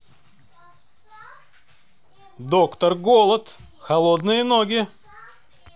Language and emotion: Russian, positive